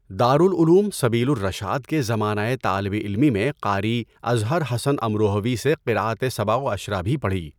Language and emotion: Urdu, neutral